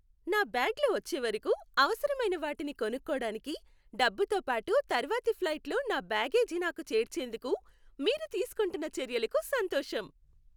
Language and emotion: Telugu, happy